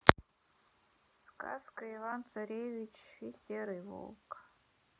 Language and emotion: Russian, sad